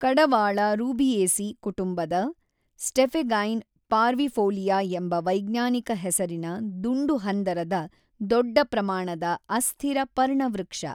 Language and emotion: Kannada, neutral